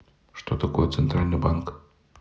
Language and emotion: Russian, neutral